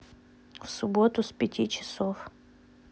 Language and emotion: Russian, neutral